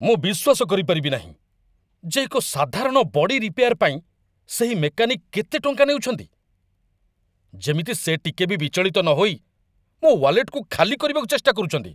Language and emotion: Odia, angry